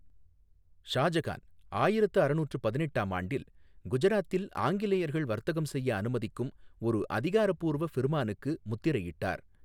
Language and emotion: Tamil, neutral